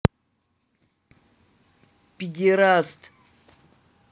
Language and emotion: Russian, neutral